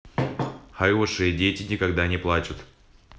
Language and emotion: Russian, neutral